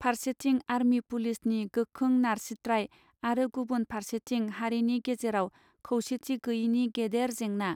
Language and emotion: Bodo, neutral